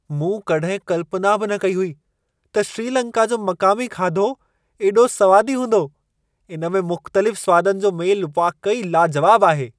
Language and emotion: Sindhi, surprised